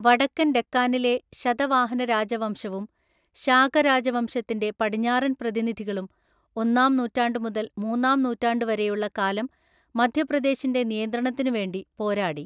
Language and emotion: Malayalam, neutral